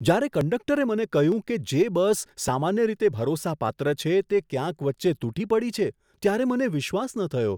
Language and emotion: Gujarati, surprised